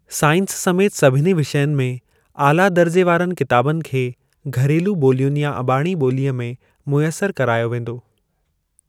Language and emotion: Sindhi, neutral